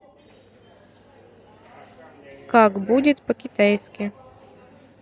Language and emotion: Russian, neutral